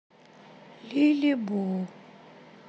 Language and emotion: Russian, sad